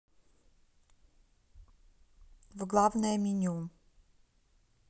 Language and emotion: Russian, neutral